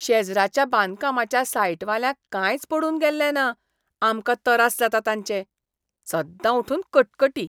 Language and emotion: Goan Konkani, disgusted